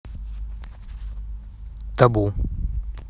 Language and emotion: Russian, neutral